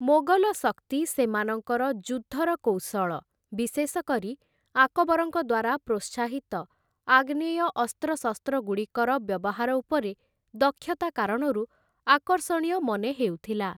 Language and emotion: Odia, neutral